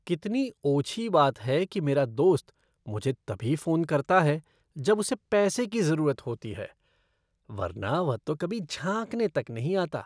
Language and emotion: Hindi, disgusted